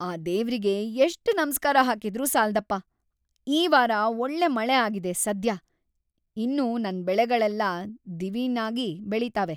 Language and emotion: Kannada, happy